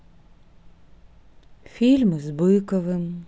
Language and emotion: Russian, sad